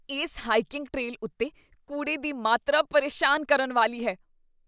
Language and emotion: Punjabi, disgusted